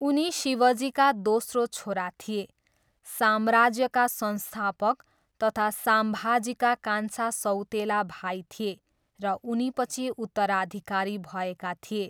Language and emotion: Nepali, neutral